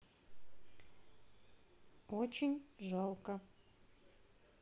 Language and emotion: Russian, neutral